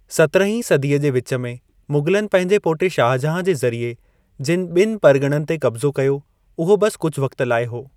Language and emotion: Sindhi, neutral